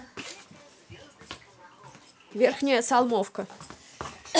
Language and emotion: Russian, neutral